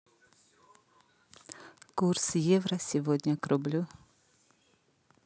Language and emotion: Russian, neutral